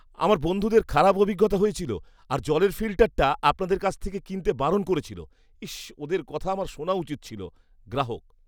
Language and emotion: Bengali, disgusted